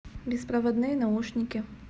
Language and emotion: Russian, neutral